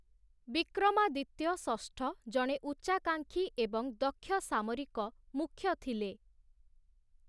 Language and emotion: Odia, neutral